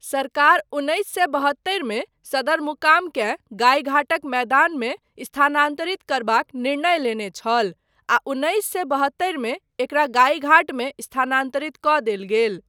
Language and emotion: Maithili, neutral